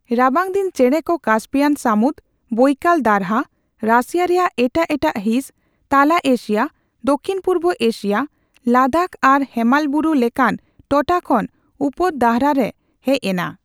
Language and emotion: Santali, neutral